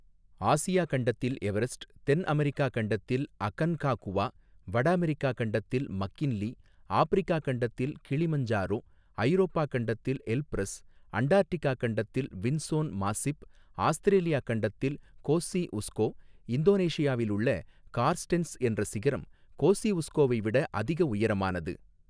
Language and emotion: Tamil, neutral